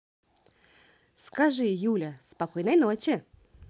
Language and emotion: Russian, positive